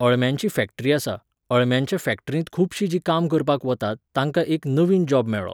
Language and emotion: Goan Konkani, neutral